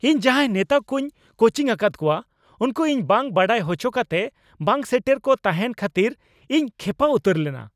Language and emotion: Santali, angry